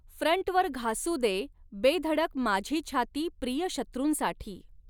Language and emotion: Marathi, neutral